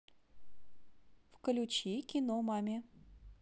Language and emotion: Russian, neutral